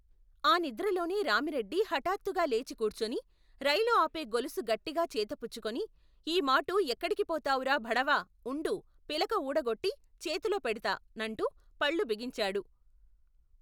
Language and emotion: Telugu, neutral